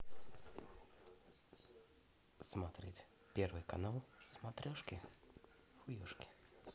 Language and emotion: Russian, positive